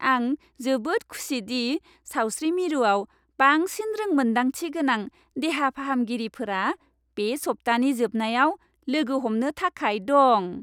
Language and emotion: Bodo, happy